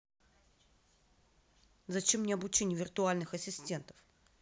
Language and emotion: Russian, angry